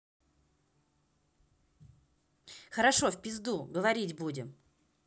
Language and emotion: Russian, angry